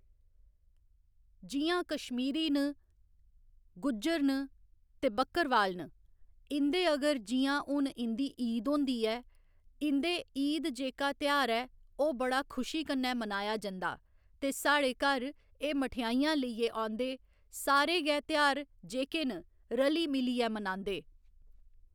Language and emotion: Dogri, neutral